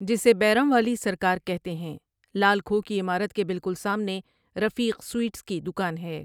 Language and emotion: Urdu, neutral